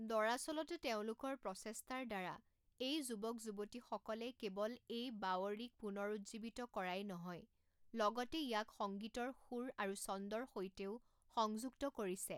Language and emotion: Assamese, neutral